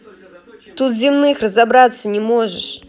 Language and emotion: Russian, angry